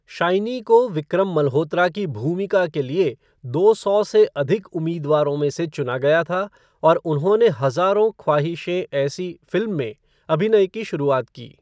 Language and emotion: Hindi, neutral